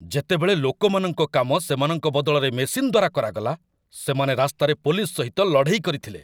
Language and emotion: Odia, angry